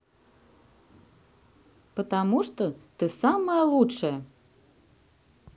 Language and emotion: Russian, positive